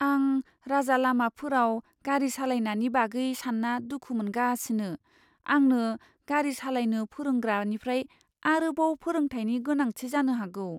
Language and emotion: Bodo, fearful